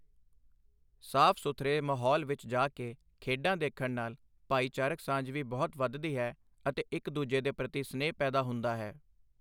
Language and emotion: Punjabi, neutral